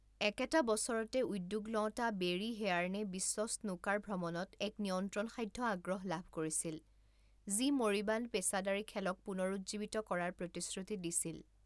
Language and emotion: Assamese, neutral